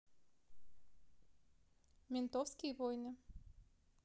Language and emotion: Russian, neutral